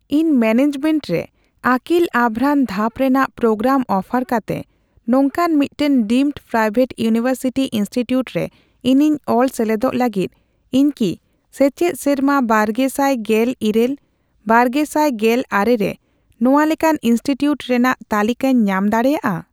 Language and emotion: Santali, neutral